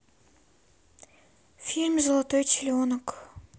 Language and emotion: Russian, sad